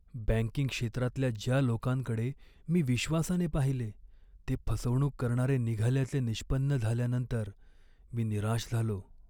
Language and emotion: Marathi, sad